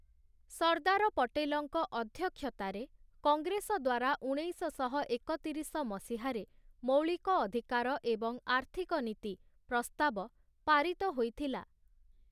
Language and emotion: Odia, neutral